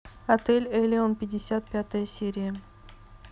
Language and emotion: Russian, neutral